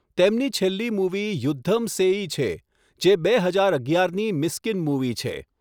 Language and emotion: Gujarati, neutral